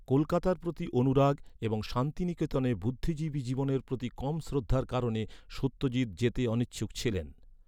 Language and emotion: Bengali, neutral